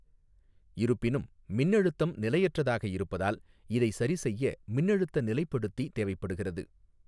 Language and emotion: Tamil, neutral